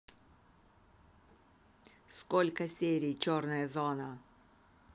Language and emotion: Russian, angry